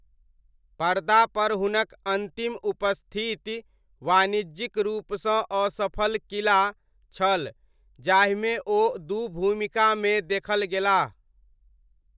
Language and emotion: Maithili, neutral